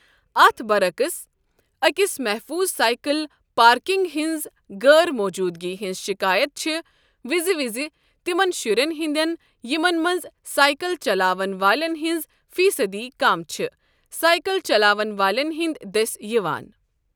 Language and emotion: Kashmiri, neutral